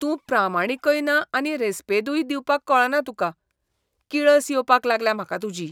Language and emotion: Goan Konkani, disgusted